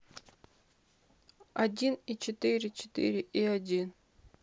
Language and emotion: Russian, sad